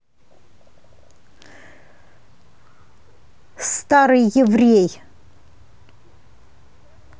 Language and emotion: Russian, angry